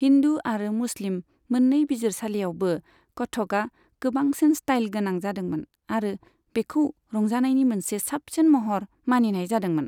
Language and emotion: Bodo, neutral